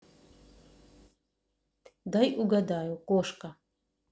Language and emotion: Russian, neutral